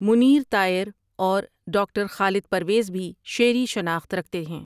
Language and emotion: Urdu, neutral